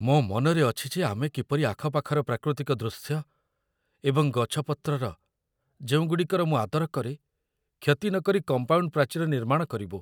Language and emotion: Odia, fearful